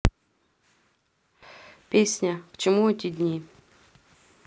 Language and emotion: Russian, neutral